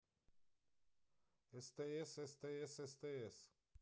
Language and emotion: Russian, neutral